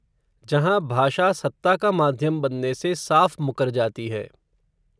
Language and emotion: Hindi, neutral